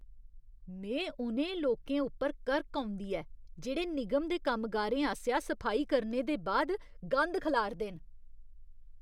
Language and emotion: Dogri, disgusted